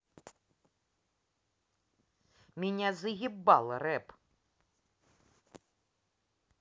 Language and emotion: Russian, angry